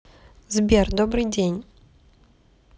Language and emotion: Russian, neutral